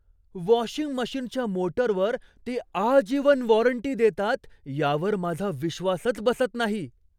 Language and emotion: Marathi, surprised